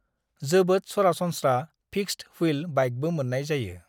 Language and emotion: Bodo, neutral